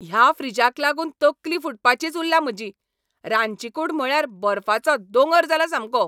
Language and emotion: Goan Konkani, angry